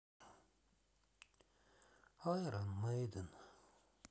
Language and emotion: Russian, sad